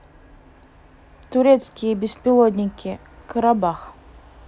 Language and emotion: Russian, neutral